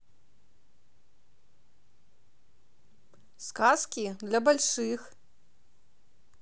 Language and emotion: Russian, positive